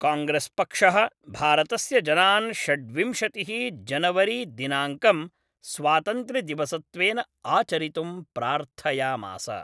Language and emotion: Sanskrit, neutral